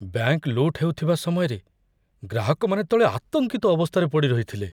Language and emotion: Odia, fearful